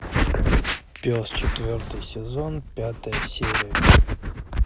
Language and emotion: Russian, neutral